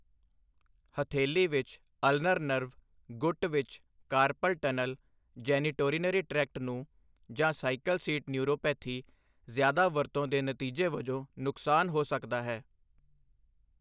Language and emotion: Punjabi, neutral